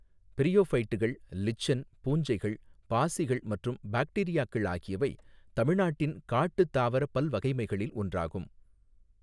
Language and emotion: Tamil, neutral